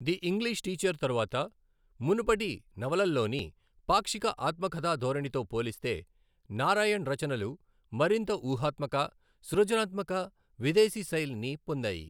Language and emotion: Telugu, neutral